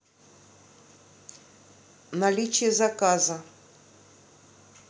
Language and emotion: Russian, neutral